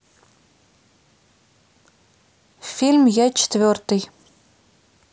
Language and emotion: Russian, neutral